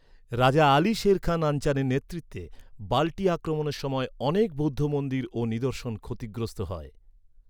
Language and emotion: Bengali, neutral